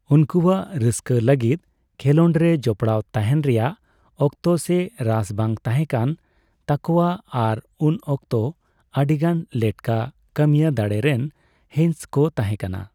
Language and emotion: Santali, neutral